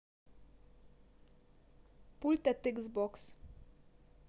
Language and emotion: Russian, neutral